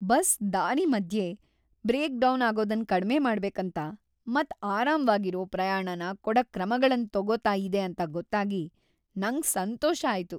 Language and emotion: Kannada, happy